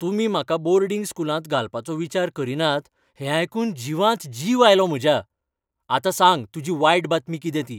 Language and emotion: Goan Konkani, happy